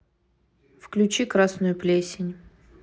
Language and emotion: Russian, neutral